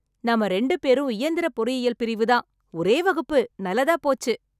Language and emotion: Tamil, happy